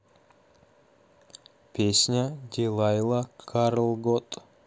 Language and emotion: Russian, neutral